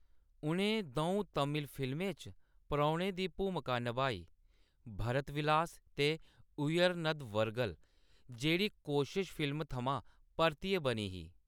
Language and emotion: Dogri, neutral